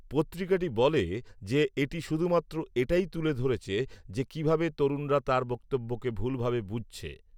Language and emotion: Bengali, neutral